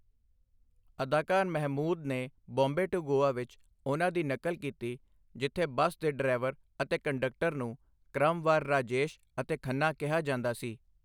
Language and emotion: Punjabi, neutral